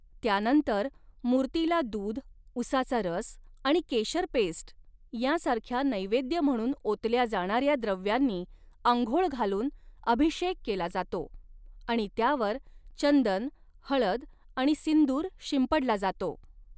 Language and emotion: Marathi, neutral